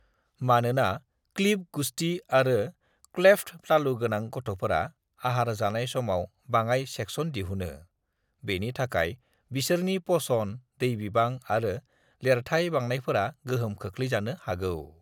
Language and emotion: Bodo, neutral